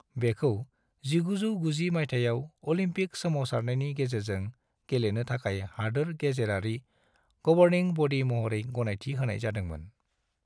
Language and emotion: Bodo, neutral